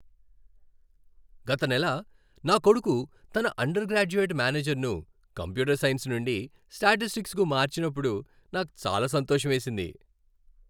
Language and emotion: Telugu, happy